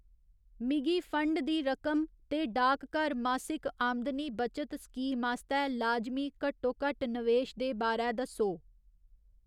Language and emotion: Dogri, neutral